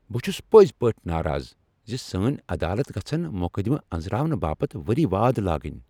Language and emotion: Kashmiri, angry